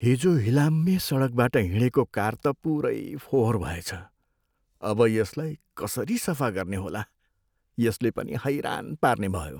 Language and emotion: Nepali, sad